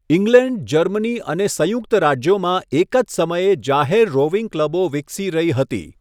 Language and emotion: Gujarati, neutral